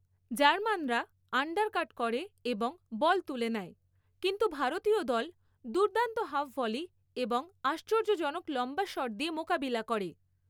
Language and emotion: Bengali, neutral